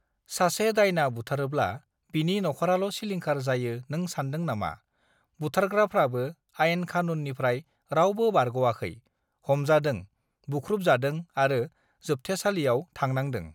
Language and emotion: Bodo, neutral